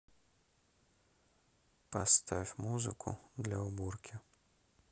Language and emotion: Russian, neutral